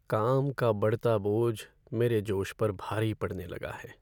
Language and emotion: Hindi, sad